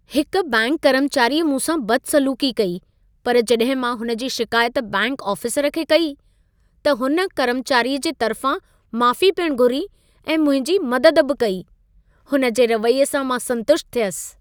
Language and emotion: Sindhi, happy